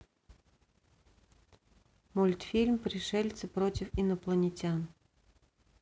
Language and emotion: Russian, neutral